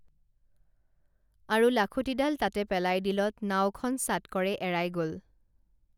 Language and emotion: Assamese, neutral